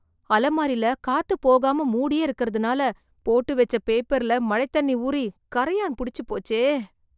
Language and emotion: Tamil, disgusted